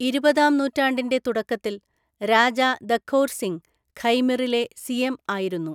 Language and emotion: Malayalam, neutral